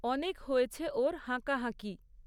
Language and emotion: Bengali, neutral